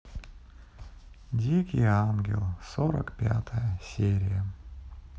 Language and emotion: Russian, sad